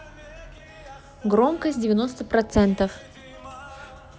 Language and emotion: Russian, neutral